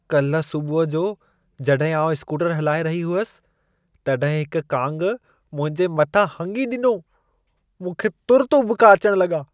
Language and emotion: Sindhi, disgusted